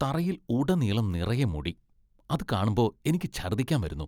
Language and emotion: Malayalam, disgusted